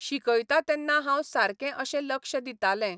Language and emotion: Goan Konkani, neutral